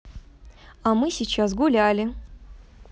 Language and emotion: Russian, positive